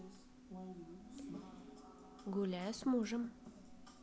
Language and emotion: Russian, neutral